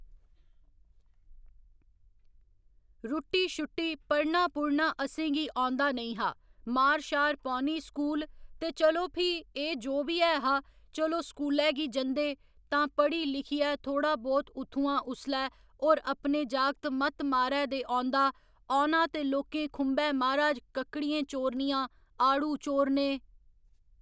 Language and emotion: Dogri, neutral